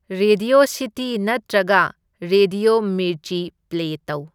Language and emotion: Manipuri, neutral